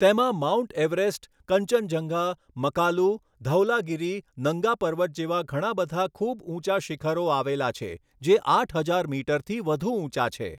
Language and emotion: Gujarati, neutral